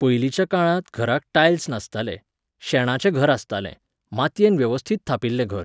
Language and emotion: Goan Konkani, neutral